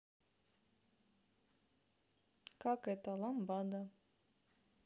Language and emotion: Russian, neutral